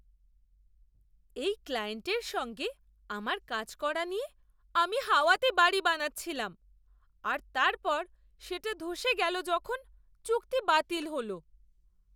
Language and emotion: Bengali, surprised